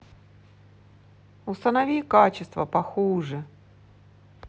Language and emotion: Russian, neutral